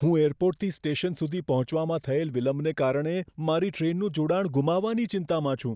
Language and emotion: Gujarati, fearful